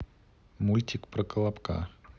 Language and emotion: Russian, neutral